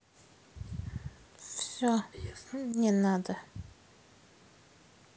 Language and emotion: Russian, sad